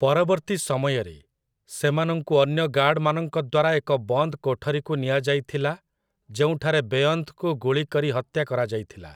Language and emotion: Odia, neutral